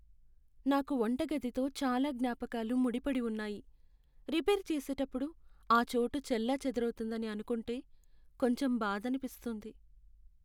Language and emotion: Telugu, sad